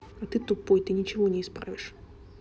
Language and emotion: Russian, angry